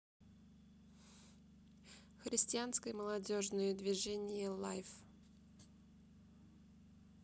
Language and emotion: Russian, neutral